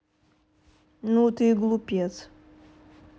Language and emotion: Russian, neutral